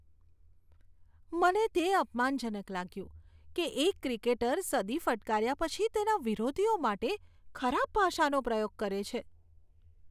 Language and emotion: Gujarati, disgusted